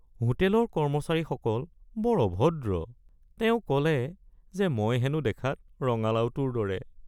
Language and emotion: Assamese, sad